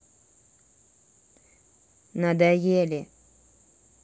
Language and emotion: Russian, neutral